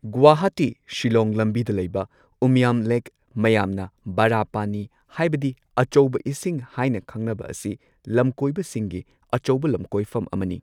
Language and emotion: Manipuri, neutral